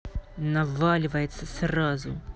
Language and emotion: Russian, angry